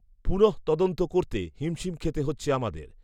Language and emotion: Bengali, neutral